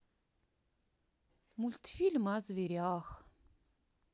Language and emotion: Russian, sad